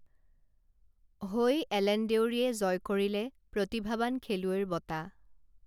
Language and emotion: Assamese, neutral